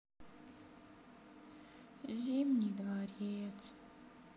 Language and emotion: Russian, sad